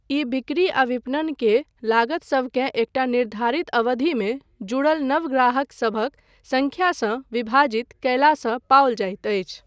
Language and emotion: Maithili, neutral